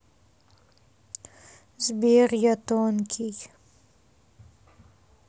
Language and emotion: Russian, sad